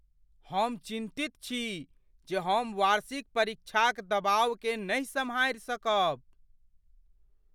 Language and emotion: Maithili, fearful